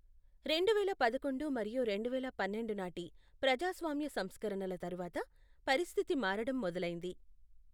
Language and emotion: Telugu, neutral